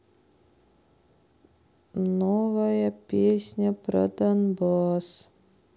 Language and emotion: Russian, sad